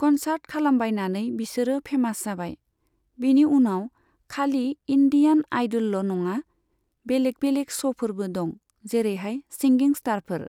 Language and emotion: Bodo, neutral